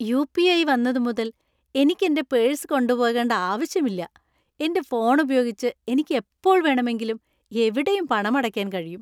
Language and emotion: Malayalam, happy